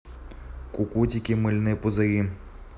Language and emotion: Russian, neutral